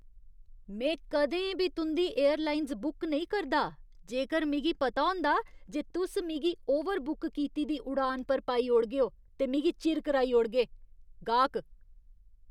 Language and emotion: Dogri, disgusted